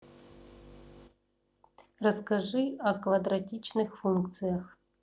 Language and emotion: Russian, neutral